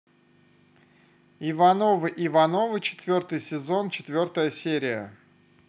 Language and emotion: Russian, positive